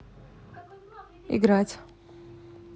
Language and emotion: Russian, neutral